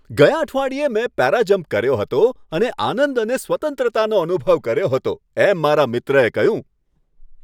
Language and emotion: Gujarati, happy